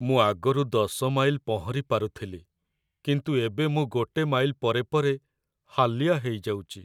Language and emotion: Odia, sad